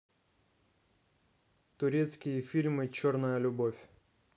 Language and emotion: Russian, neutral